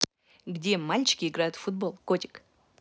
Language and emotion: Russian, positive